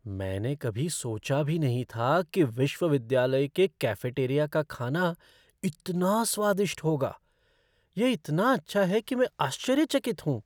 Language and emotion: Hindi, surprised